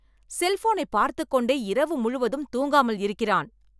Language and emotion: Tamil, angry